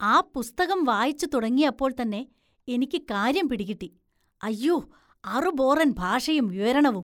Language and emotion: Malayalam, disgusted